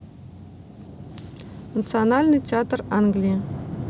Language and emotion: Russian, neutral